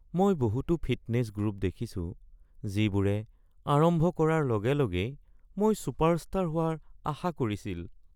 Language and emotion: Assamese, sad